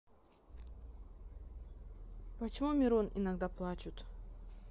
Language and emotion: Russian, neutral